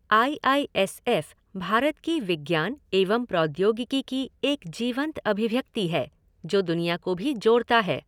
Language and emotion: Hindi, neutral